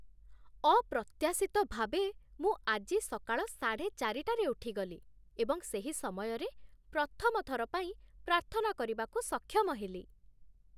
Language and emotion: Odia, surprised